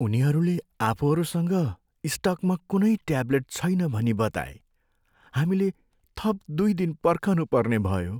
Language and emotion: Nepali, sad